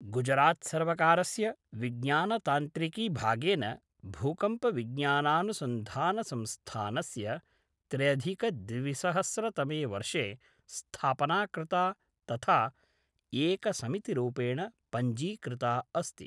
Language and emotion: Sanskrit, neutral